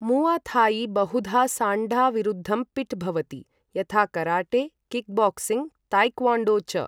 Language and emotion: Sanskrit, neutral